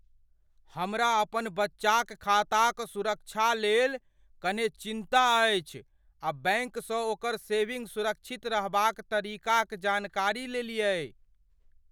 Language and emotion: Maithili, fearful